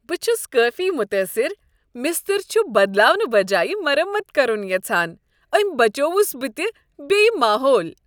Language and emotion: Kashmiri, happy